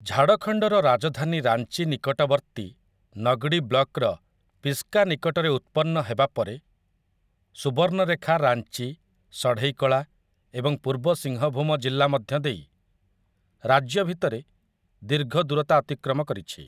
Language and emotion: Odia, neutral